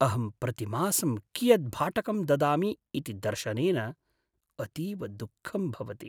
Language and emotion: Sanskrit, sad